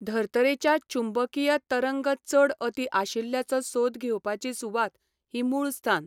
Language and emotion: Goan Konkani, neutral